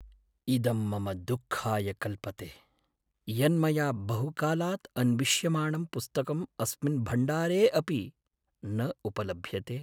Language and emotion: Sanskrit, sad